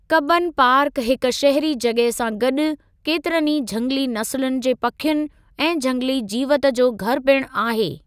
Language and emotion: Sindhi, neutral